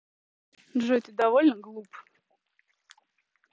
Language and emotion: Russian, neutral